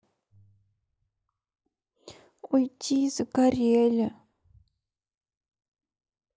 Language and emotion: Russian, sad